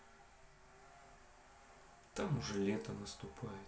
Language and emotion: Russian, sad